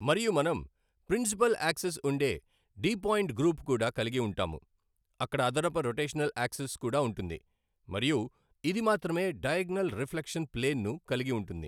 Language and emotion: Telugu, neutral